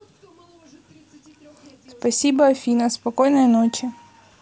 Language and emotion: Russian, neutral